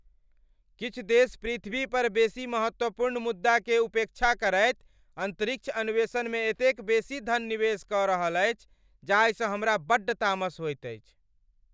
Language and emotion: Maithili, angry